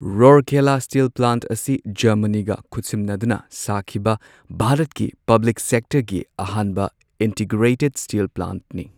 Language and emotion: Manipuri, neutral